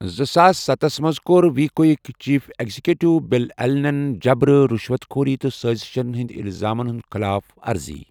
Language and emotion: Kashmiri, neutral